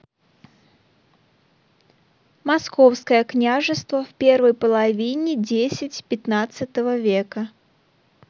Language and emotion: Russian, neutral